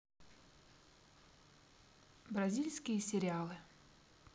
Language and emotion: Russian, neutral